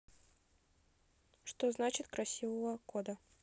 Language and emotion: Russian, neutral